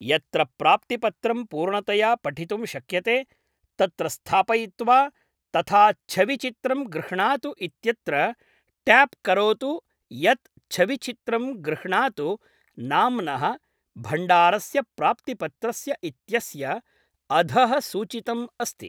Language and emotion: Sanskrit, neutral